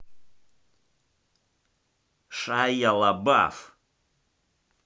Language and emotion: Russian, angry